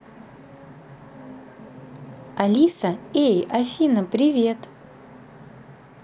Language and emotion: Russian, positive